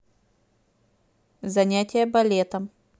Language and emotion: Russian, neutral